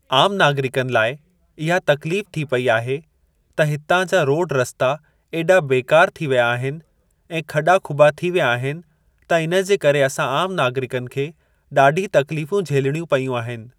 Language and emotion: Sindhi, neutral